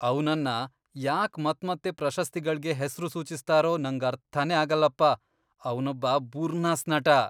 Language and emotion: Kannada, disgusted